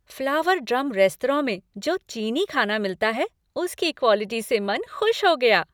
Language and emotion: Hindi, happy